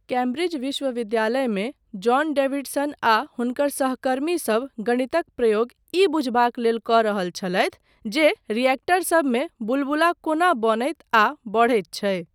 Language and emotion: Maithili, neutral